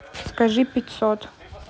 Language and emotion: Russian, neutral